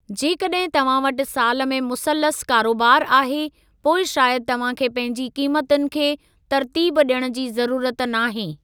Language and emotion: Sindhi, neutral